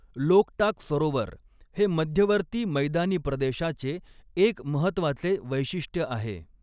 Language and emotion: Marathi, neutral